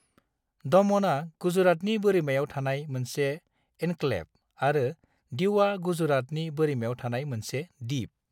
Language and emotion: Bodo, neutral